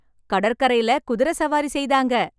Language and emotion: Tamil, happy